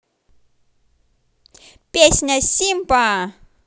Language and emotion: Russian, positive